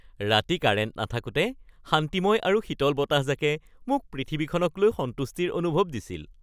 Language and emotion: Assamese, happy